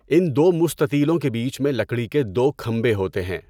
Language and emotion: Urdu, neutral